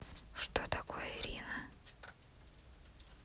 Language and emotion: Russian, neutral